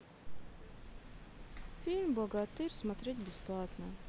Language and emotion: Russian, neutral